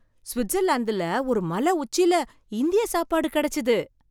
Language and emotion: Tamil, surprised